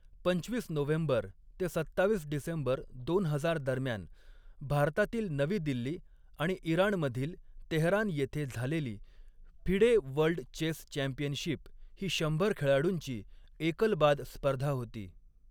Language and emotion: Marathi, neutral